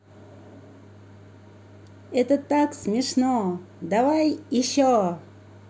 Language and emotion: Russian, positive